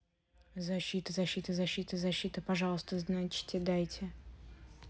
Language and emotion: Russian, neutral